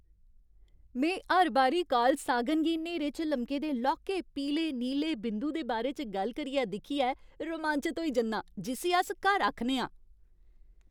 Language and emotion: Dogri, happy